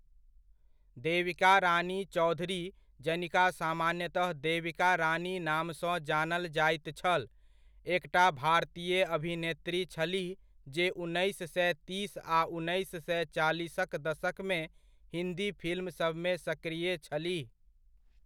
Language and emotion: Maithili, neutral